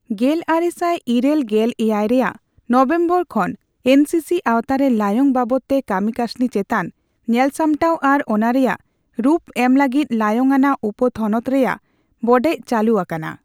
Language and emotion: Santali, neutral